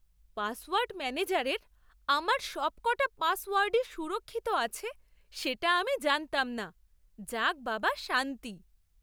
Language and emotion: Bengali, surprised